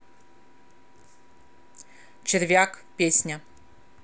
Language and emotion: Russian, neutral